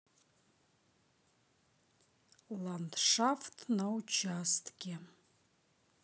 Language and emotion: Russian, neutral